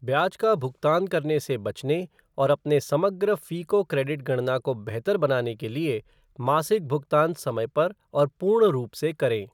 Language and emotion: Hindi, neutral